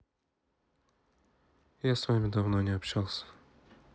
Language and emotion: Russian, neutral